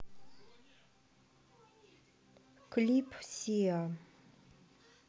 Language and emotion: Russian, neutral